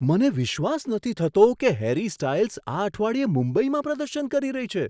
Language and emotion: Gujarati, surprised